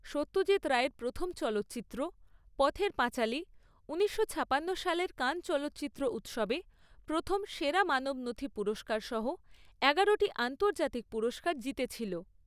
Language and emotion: Bengali, neutral